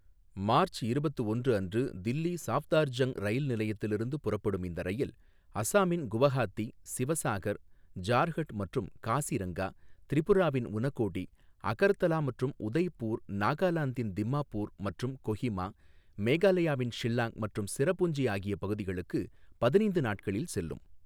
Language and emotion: Tamil, neutral